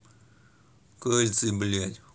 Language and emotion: Russian, angry